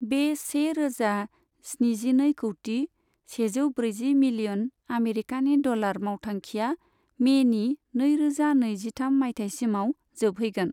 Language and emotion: Bodo, neutral